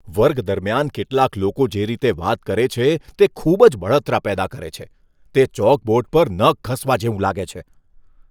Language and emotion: Gujarati, disgusted